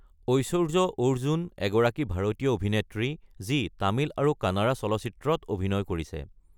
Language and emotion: Assamese, neutral